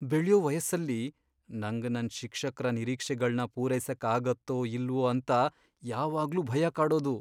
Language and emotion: Kannada, fearful